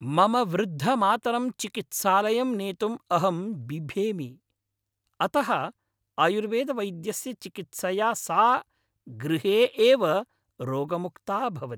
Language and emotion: Sanskrit, happy